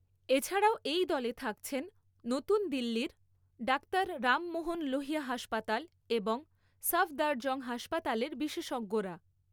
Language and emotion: Bengali, neutral